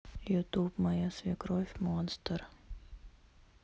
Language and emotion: Russian, neutral